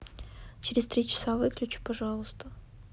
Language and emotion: Russian, neutral